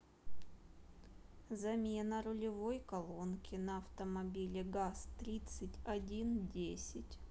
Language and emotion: Russian, neutral